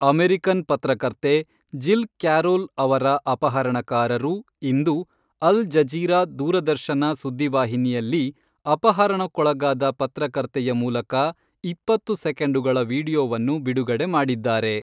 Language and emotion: Kannada, neutral